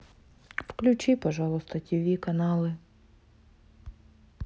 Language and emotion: Russian, sad